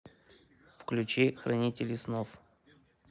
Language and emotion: Russian, neutral